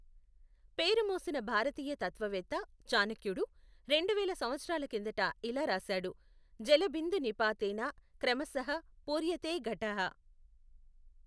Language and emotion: Telugu, neutral